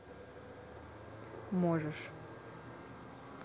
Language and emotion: Russian, neutral